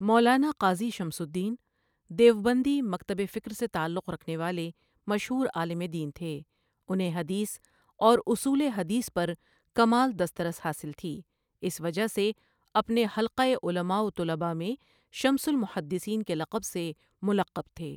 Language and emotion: Urdu, neutral